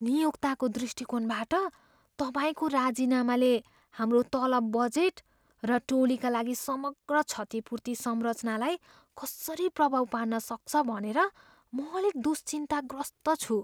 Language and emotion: Nepali, fearful